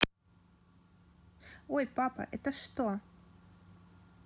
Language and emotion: Russian, neutral